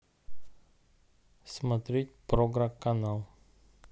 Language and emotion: Russian, neutral